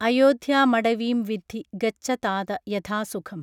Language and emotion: Malayalam, neutral